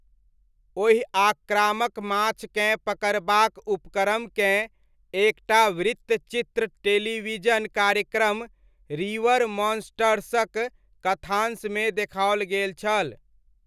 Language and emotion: Maithili, neutral